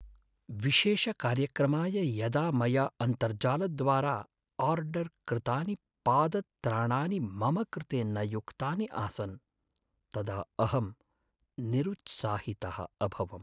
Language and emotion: Sanskrit, sad